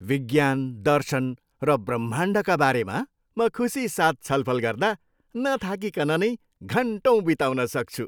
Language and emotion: Nepali, happy